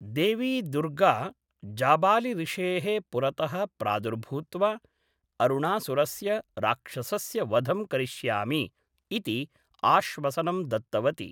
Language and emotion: Sanskrit, neutral